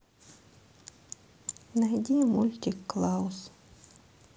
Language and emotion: Russian, sad